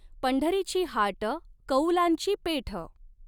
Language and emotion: Marathi, neutral